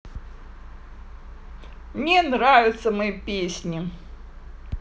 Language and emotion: Russian, positive